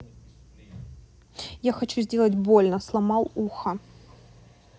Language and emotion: Russian, neutral